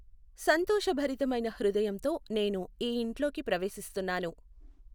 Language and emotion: Telugu, neutral